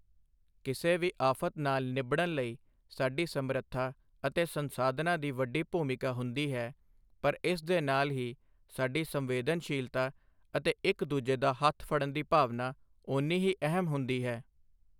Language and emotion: Punjabi, neutral